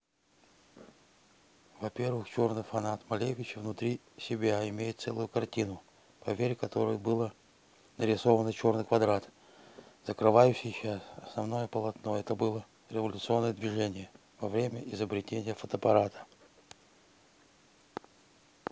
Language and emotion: Russian, neutral